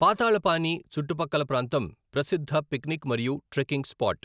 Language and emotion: Telugu, neutral